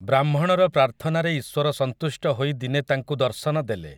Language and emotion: Odia, neutral